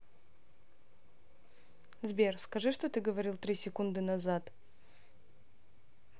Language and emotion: Russian, neutral